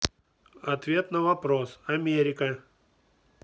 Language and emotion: Russian, neutral